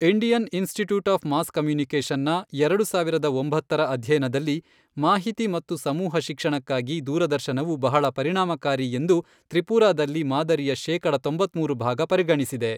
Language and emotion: Kannada, neutral